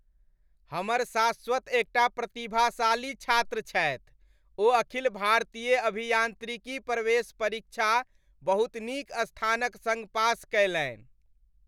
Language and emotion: Maithili, happy